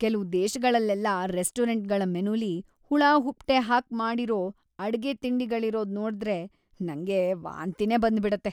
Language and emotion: Kannada, disgusted